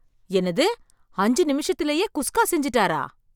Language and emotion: Tamil, surprised